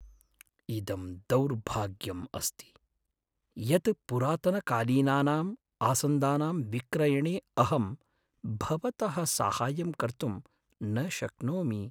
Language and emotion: Sanskrit, sad